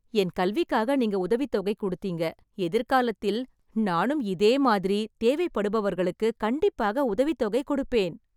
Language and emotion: Tamil, happy